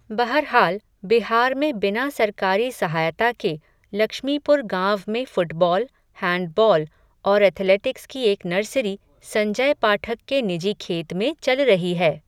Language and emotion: Hindi, neutral